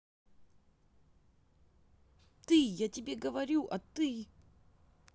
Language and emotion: Russian, angry